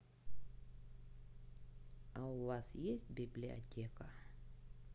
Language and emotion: Russian, neutral